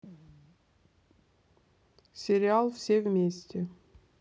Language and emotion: Russian, neutral